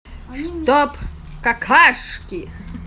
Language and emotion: Russian, positive